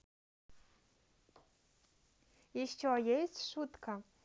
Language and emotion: Russian, neutral